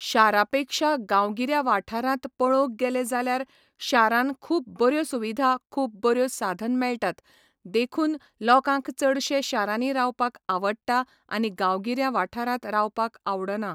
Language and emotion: Goan Konkani, neutral